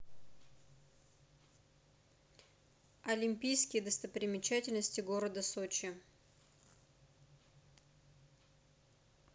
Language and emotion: Russian, neutral